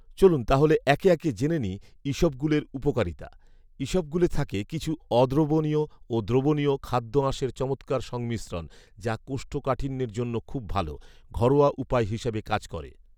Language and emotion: Bengali, neutral